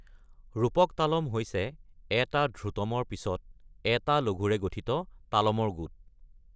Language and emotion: Assamese, neutral